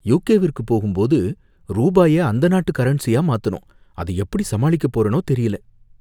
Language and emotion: Tamil, fearful